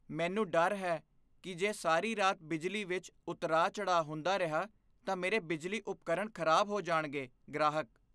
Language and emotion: Punjabi, fearful